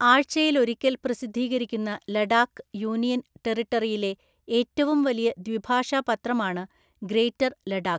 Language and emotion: Malayalam, neutral